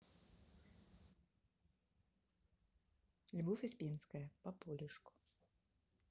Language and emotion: Russian, neutral